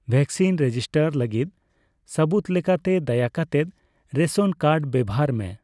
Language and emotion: Santali, neutral